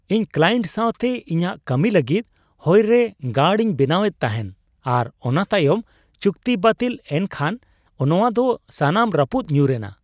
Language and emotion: Santali, surprised